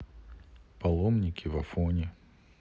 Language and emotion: Russian, neutral